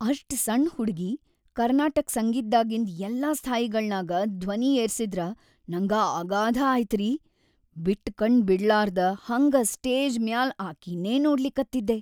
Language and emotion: Kannada, happy